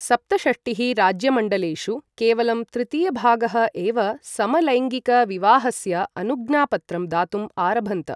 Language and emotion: Sanskrit, neutral